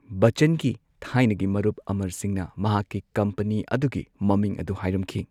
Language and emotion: Manipuri, neutral